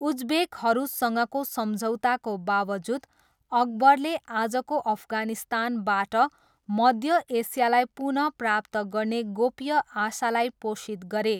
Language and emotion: Nepali, neutral